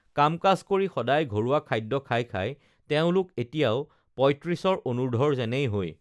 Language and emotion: Assamese, neutral